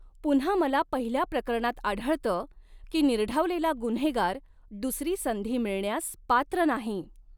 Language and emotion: Marathi, neutral